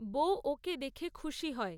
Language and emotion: Bengali, neutral